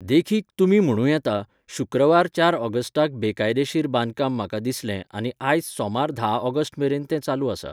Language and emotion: Goan Konkani, neutral